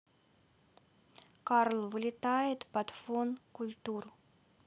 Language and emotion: Russian, neutral